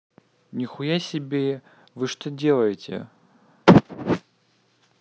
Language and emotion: Russian, angry